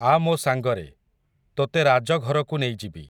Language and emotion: Odia, neutral